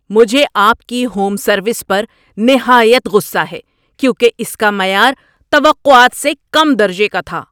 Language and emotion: Urdu, angry